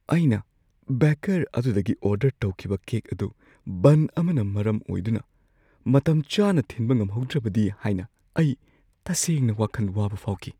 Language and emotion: Manipuri, fearful